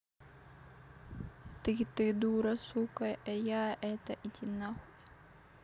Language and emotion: Russian, neutral